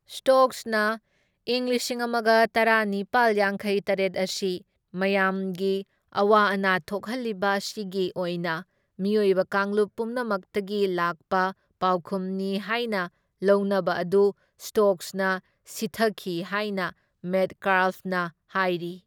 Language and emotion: Manipuri, neutral